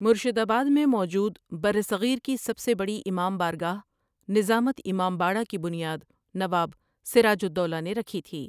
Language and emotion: Urdu, neutral